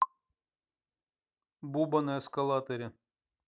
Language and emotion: Russian, neutral